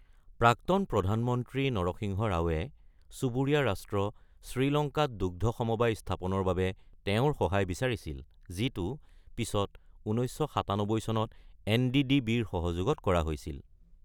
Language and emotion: Assamese, neutral